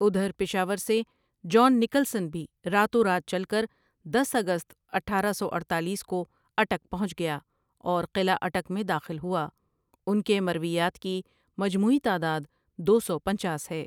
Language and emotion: Urdu, neutral